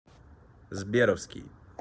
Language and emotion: Russian, neutral